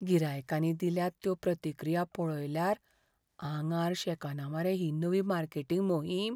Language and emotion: Goan Konkani, fearful